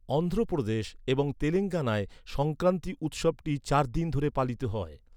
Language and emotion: Bengali, neutral